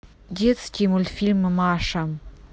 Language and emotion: Russian, neutral